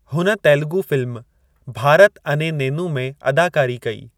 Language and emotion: Sindhi, neutral